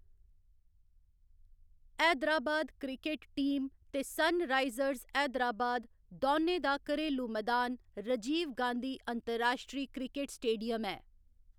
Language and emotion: Dogri, neutral